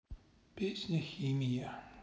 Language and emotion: Russian, sad